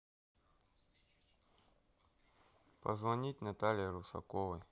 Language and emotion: Russian, neutral